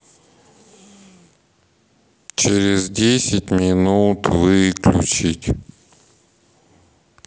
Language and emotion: Russian, sad